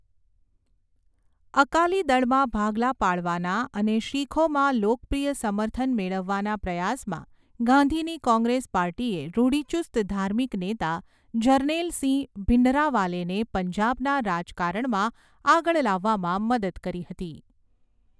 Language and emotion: Gujarati, neutral